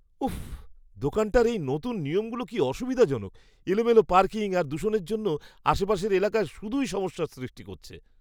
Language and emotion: Bengali, disgusted